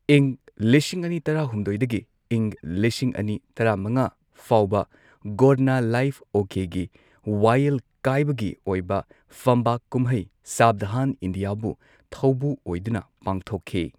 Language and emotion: Manipuri, neutral